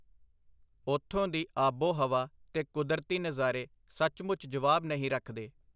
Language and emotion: Punjabi, neutral